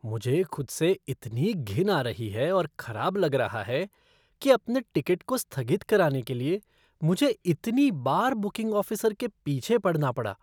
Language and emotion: Hindi, disgusted